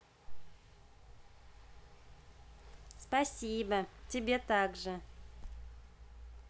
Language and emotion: Russian, positive